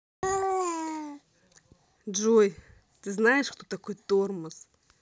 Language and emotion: Russian, angry